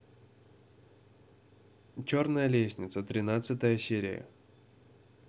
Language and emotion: Russian, neutral